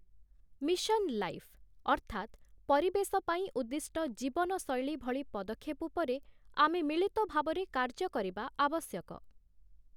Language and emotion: Odia, neutral